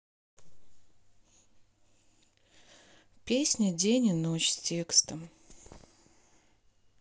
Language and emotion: Russian, neutral